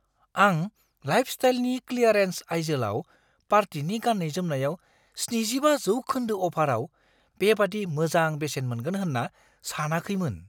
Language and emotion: Bodo, surprised